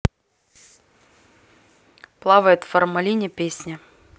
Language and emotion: Russian, neutral